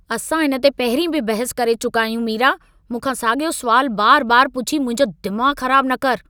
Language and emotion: Sindhi, angry